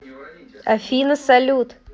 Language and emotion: Russian, positive